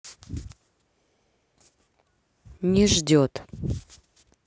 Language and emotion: Russian, neutral